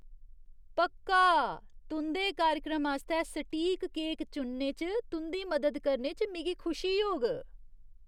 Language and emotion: Dogri, disgusted